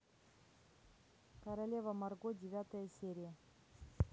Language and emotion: Russian, neutral